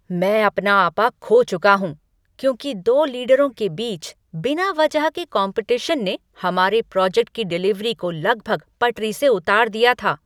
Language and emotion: Hindi, angry